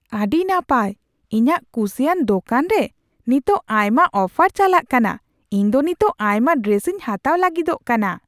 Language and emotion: Santali, surprised